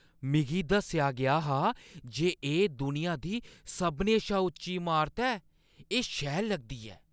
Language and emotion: Dogri, surprised